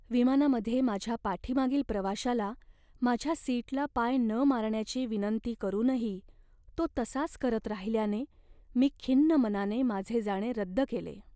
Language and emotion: Marathi, sad